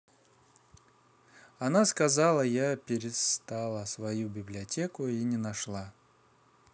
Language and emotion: Russian, neutral